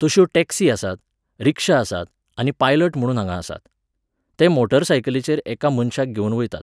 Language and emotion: Goan Konkani, neutral